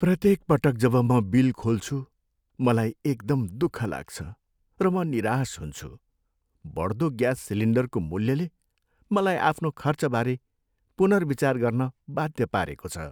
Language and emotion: Nepali, sad